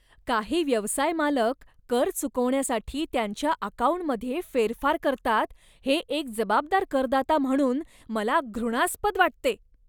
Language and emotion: Marathi, disgusted